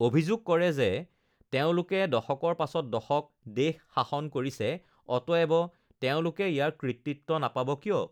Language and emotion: Assamese, neutral